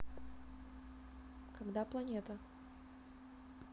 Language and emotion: Russian, neutral